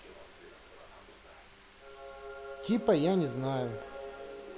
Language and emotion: Russian, neutral